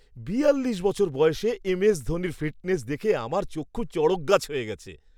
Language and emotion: Bengali, surprised